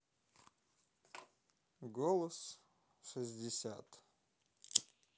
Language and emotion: Russian, neutral